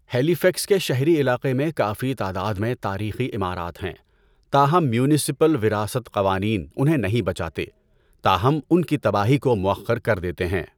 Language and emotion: Urdu, neutral